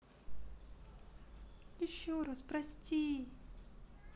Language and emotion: Russian, sad